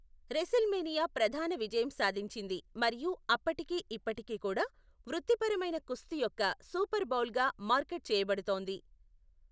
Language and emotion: Telugu, neutral